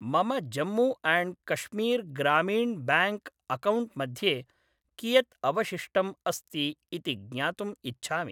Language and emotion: Sanskrit, neutral